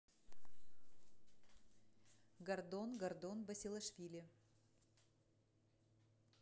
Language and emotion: Russian, neutral